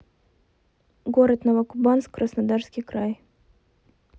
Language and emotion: Russian, neutral